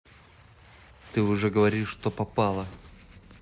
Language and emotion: Russian, neutral